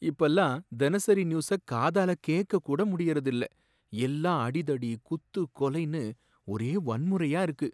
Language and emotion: Tamil, sad